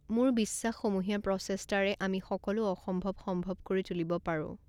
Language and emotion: Assamese, neutral